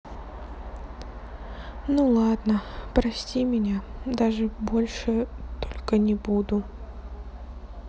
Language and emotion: Russian, sad